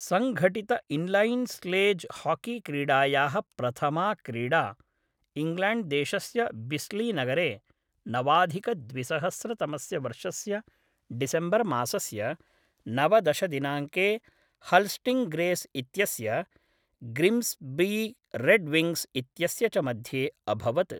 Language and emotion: Sanskrit, neutral